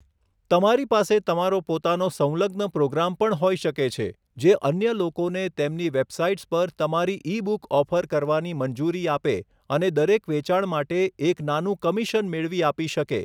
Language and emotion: Gujarati, neutral